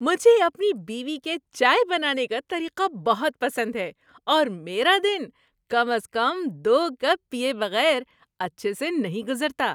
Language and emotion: Urdu, happy